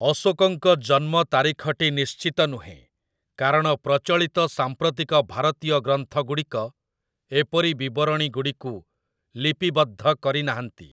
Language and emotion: Odia, neutral